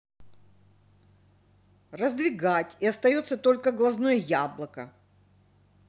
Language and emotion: Russian, angry